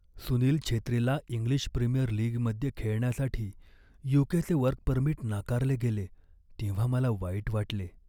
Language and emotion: Marathi, sad